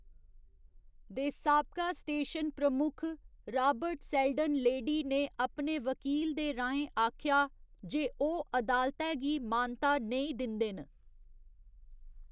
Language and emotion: Dogri, neutral